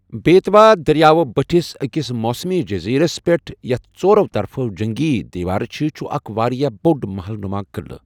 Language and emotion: Kashmiri, neutral